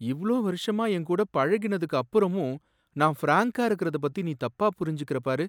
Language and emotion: Tamil, sad